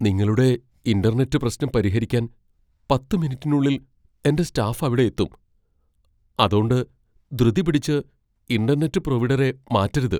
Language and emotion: Malayalam, fearful